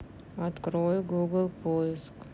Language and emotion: Russian, neutral